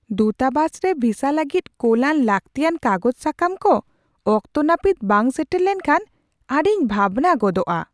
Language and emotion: Santali, surprised